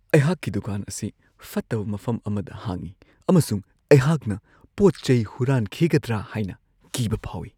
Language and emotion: Manipuri, fearful